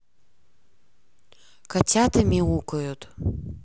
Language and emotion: Russian, neutral